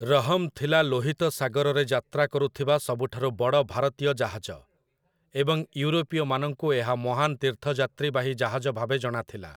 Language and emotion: Odia, neutral